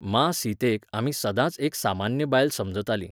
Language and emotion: Goan Konkani, neutral